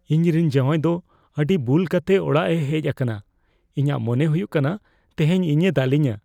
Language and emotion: Santali, fearful